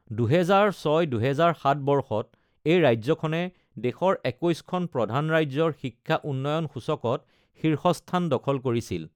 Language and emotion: Assamese, neutral